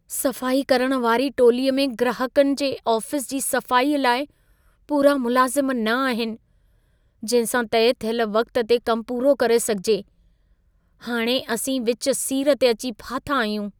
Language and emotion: Sindhi, fearful